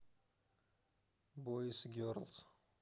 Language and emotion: Russian, neutral